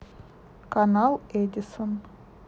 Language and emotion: Russian, neutral